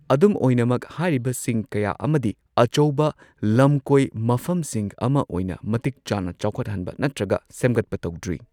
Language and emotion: Manipuri, neutral